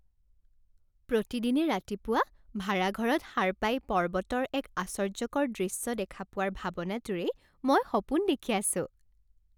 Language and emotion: Assamese, happy